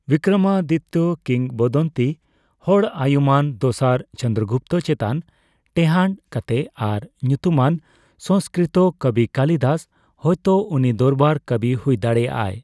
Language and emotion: Santali, neutral